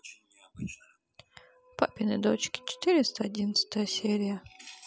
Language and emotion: Russian, sad